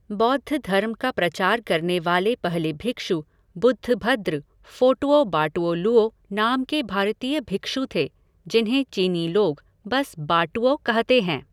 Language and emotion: Hindi, neutral